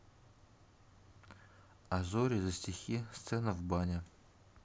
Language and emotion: Russian, neutral